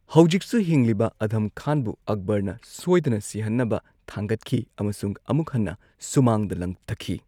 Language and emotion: Manipuri, neutral